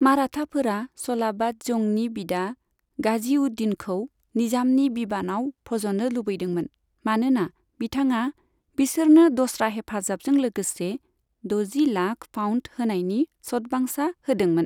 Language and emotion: Bodo, neutral